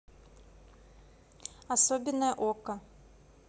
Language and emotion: Russian, neutral